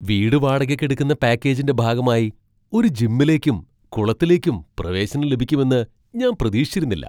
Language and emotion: Malayalam, surprised